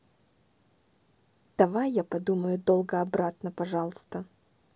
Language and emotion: Russian, neutral